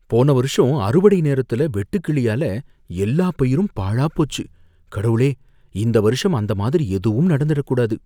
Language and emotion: Tamil, fearful